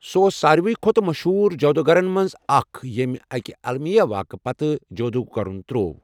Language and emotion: Kashmiri, neutral